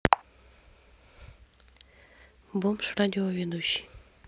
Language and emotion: Russian, neutral